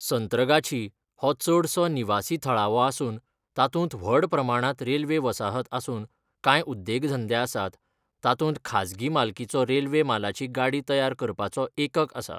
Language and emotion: Goan Konkani, neutral